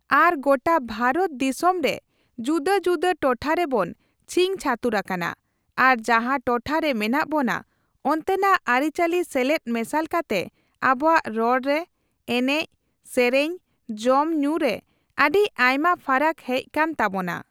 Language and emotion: Santali, neutral